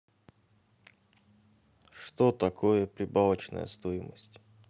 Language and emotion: Russian, neutral